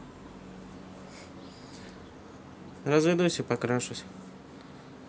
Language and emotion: Russian, neutral